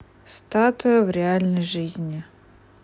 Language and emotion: Russian, neutral